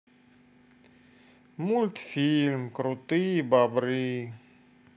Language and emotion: Russian, sad